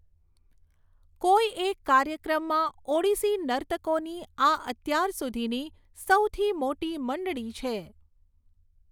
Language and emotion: Gujarati, neutral